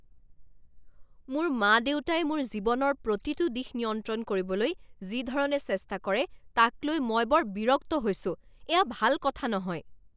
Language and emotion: Assamese, angry